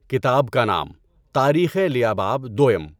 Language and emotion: Urdu, neutral